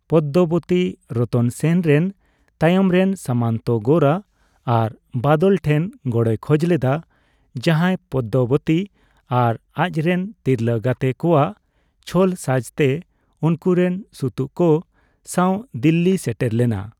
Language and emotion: Santali, neutral